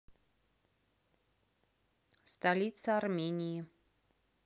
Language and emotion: Russian, neutral